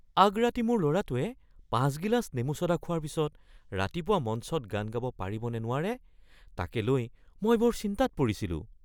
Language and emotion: Assamese, fearful